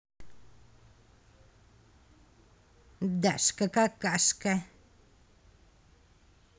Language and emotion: Russian, angry